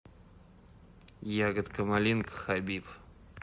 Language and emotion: Russian, neutral